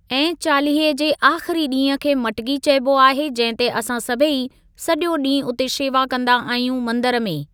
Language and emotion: Sindhi, neutral